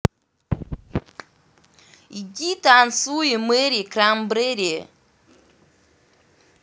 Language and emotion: Russian, angry